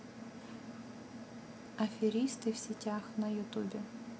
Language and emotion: Russian, neutral